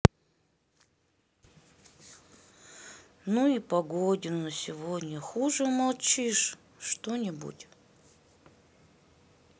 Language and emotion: Russian, sad